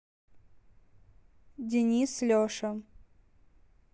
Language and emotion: Russian, neutral